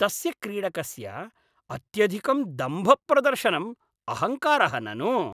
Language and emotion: Sanskrit, disgusted